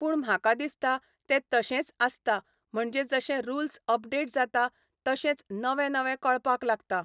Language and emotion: Goan Konkani, neutral